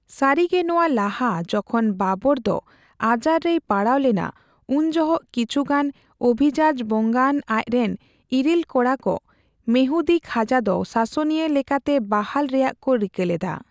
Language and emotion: Santali, neutral